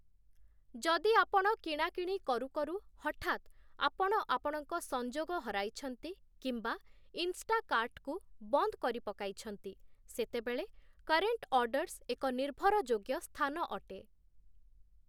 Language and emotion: Odia, neutral